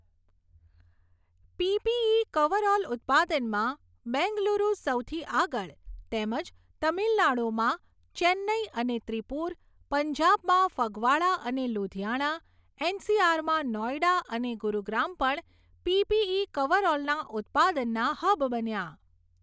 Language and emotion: Gujarati, neutral